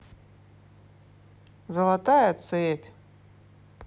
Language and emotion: Russian, neutral